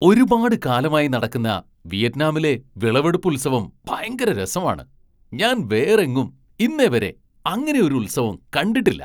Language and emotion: Malayalam, surprised